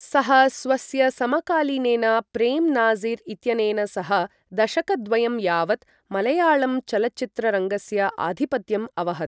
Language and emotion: Sanskrit, neutral